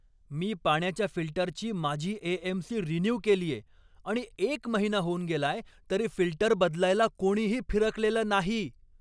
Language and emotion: Marathi, angry